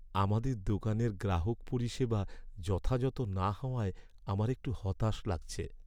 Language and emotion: Bengali, sad